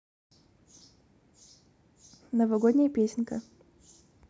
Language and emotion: Russian, neutral